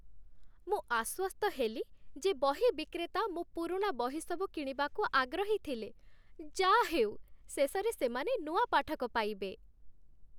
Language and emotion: Odia, happy